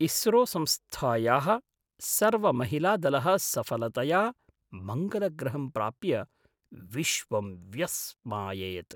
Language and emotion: Sanskrit, surprised